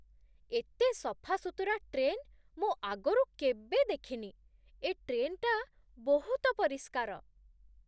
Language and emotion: Odia, surprised